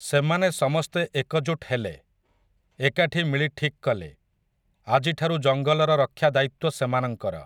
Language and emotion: Odia, neutral